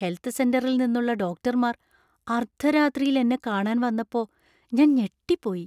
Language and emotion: Malayalam, surprised